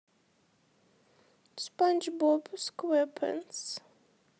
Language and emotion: Russian, sad